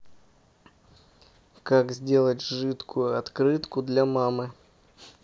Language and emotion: Russian, neutral